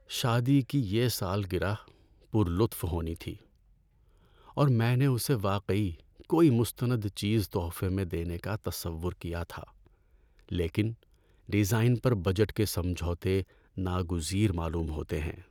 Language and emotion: Urdu, sad